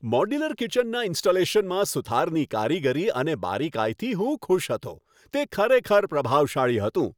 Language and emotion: Gujarati, happy